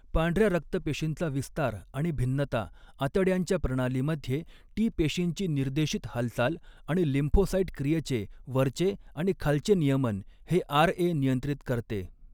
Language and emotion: Marathi, neutral